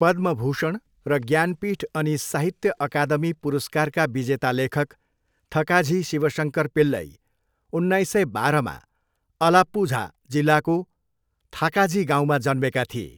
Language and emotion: Nepali, neutral